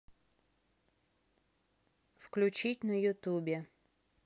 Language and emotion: Russian, neutral